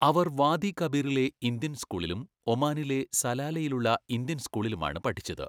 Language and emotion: Malayalam, neutral